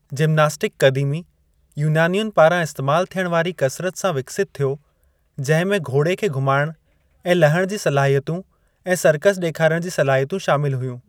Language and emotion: Sindhi, neutral